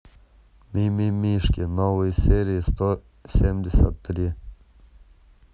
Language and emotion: Russian, neutral